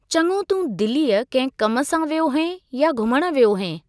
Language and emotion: Sindhi, neutral